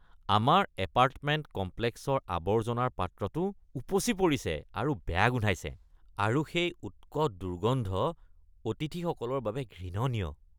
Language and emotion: Assamese, disgusted